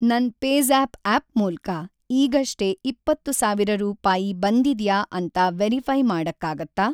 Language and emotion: Kannada, neutral